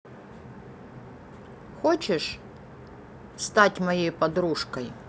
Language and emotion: Russian, neutral